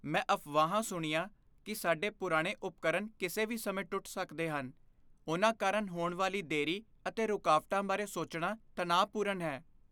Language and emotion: Punjabi, fearful